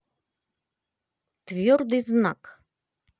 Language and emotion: Russian, positive